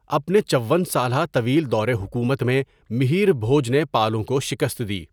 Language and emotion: Urdu, neutral